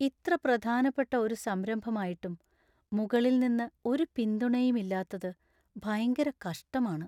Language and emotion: Malayalam, sad